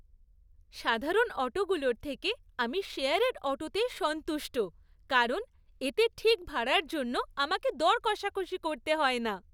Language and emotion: Bengali, happy